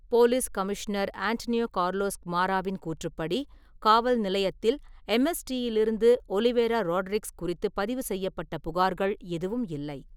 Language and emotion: Tamil, neutral